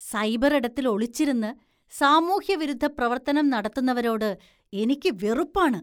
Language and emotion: Malayalam, disgusted